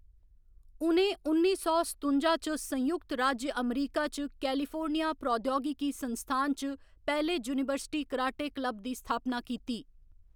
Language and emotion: Dogri, neutral